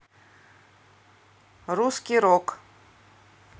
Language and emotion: Russian, neutral